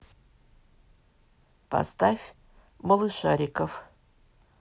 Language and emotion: Russian, neutral